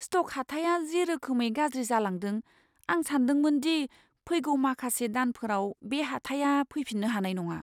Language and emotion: Bodo, fearful